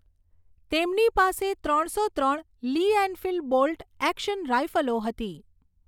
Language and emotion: Gujarati, neutral